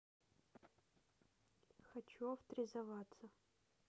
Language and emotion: Russian, neutral